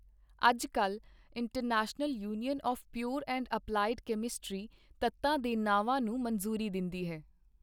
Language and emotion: Punjabi, neutral